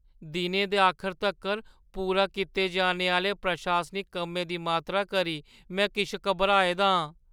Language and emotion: Dogri, fearful